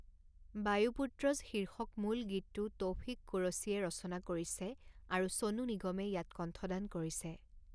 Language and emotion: Assamese, neutral